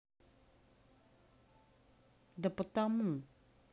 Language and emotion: Russian, angry